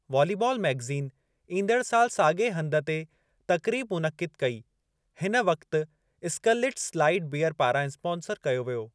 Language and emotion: Sindhi, neutral